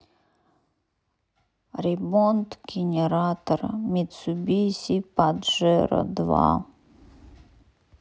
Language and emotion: Russian, sad